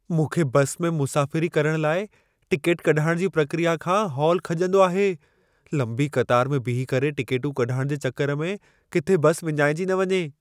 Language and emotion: Sindhi, fearful